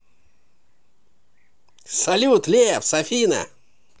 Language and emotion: Russian, positive